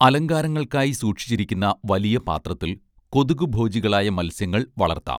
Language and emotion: Malayalam, neutral